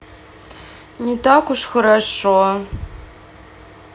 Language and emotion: Russian, sad